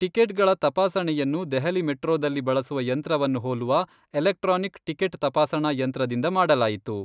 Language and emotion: Kannada, neutral